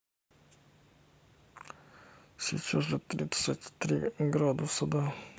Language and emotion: Russian, neutral